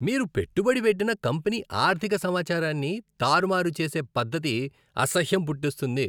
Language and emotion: Telugu, disgusted